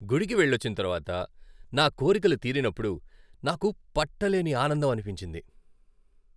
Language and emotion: Telugu, happy